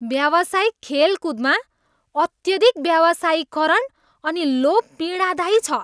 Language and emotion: Nepali, disgusted